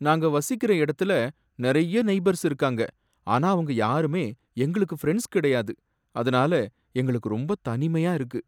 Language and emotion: Tamil, sad